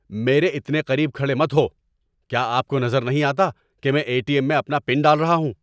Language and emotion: Urdu, angry